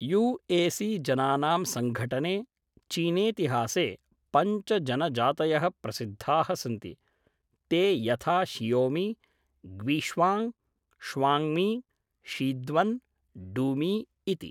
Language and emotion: Sanskrit, neutral